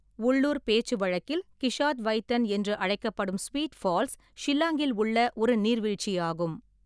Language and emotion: Tamil, neutral